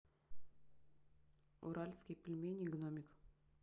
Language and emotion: Russian, neutral